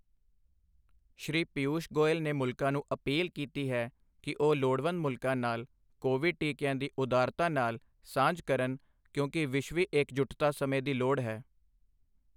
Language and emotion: Punjabi, neutral